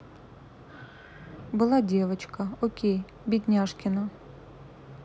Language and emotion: Russian, sad